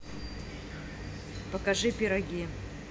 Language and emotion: Russian, neutral